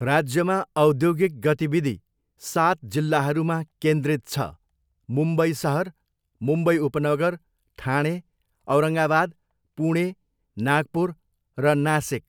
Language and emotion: Nepali, neutral